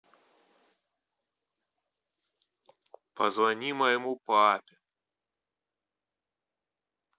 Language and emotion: Russian, neutral